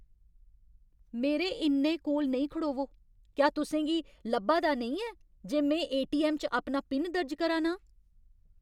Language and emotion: Dogri, angry